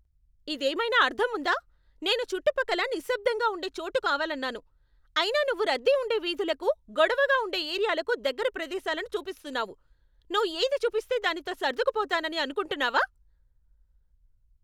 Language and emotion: Telugu, angry